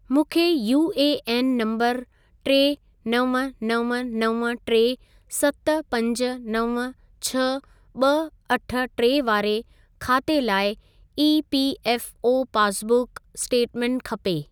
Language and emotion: Sindhi, neutral